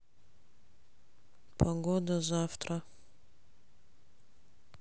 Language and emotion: Russian, neutral